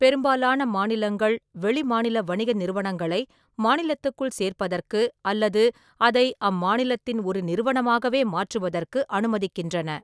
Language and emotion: Tamil, neutral